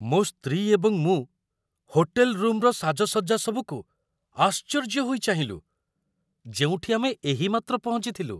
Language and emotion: Odia, surprised